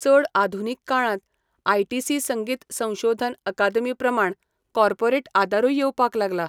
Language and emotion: Goan Konkani, neutral